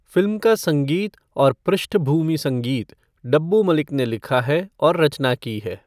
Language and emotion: Hindi, neutral